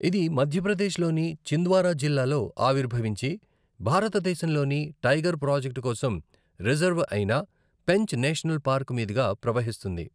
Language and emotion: Telugu, neutral